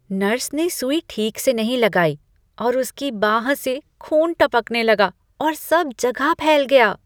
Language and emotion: Hindi, disgusted